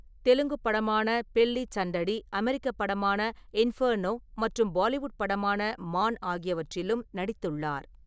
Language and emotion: Tamil, neutral